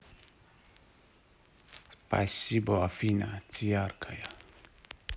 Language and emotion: Russian, positive